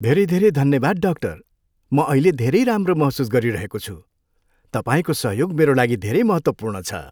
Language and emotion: Nepali, happy